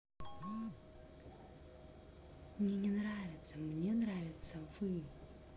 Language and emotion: Russian, neutral